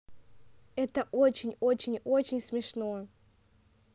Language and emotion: Russian, positive